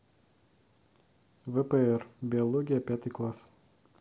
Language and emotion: Russian, neutral